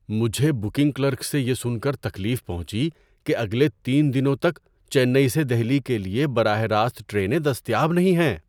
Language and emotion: Urdu, surprised